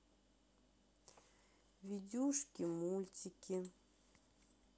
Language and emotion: Russian, sad